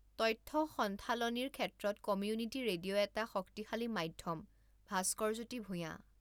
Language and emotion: Assamese, neutral